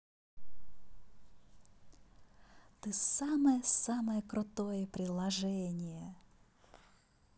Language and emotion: Russian, positive